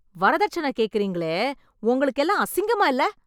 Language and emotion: Tamil, angry